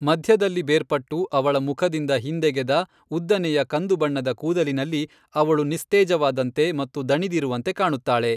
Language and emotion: Kannada, neutral